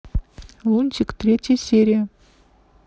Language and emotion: Russian, neutral